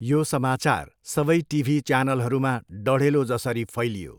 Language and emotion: Nepali, neutral